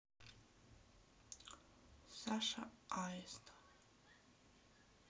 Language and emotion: Russian, neutral